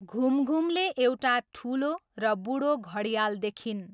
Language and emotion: Nepali, neutral